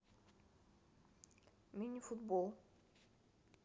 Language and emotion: Russian, neutral